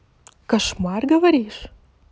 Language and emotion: Russian, positive